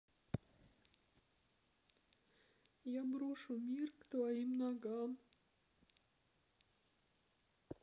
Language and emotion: Russian, sad